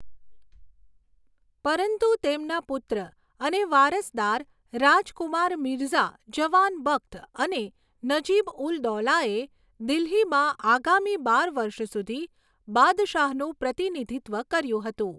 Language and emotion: Gujarati, neutral